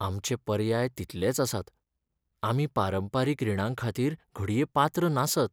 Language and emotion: Goan Konkani, sad